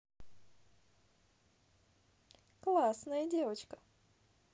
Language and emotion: Russian, positive